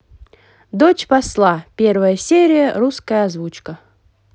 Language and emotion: Russian, positive